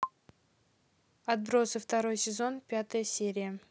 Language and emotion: Russian, neutral